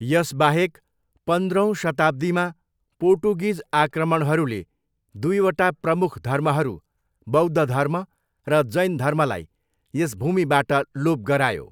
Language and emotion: Nepali, neutral